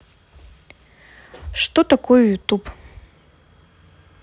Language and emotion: Russian, neutral